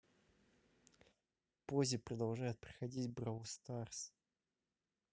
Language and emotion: Russian, neutral